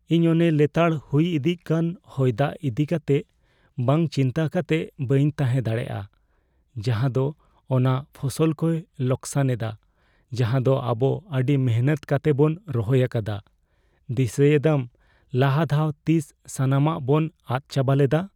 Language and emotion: Santali, fearful